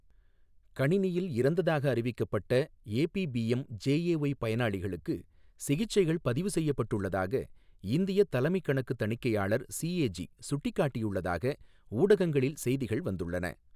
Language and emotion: Tamil, neutral